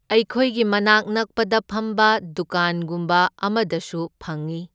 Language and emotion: Manipuri, neutral